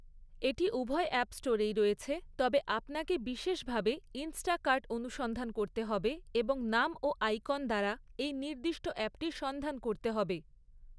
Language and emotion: Bengali, neutral